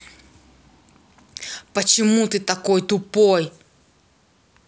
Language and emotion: Russian, angry